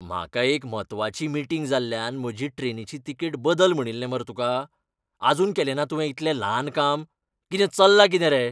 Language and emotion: Goan Konkani, angry